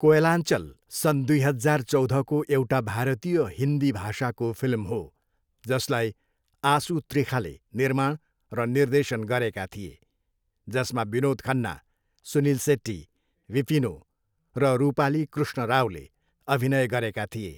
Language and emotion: Nepali, neutral